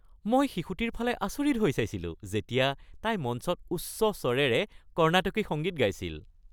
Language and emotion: Assamese, happy